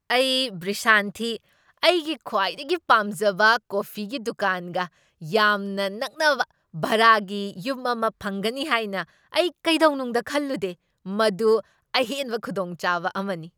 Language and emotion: Manipuri, surprised